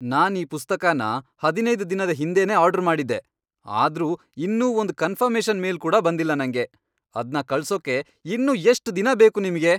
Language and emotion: Kannada, angry